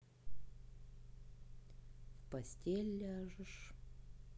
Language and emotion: Russian, sad